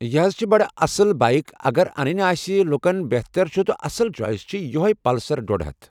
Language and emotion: Kashmiri, neutral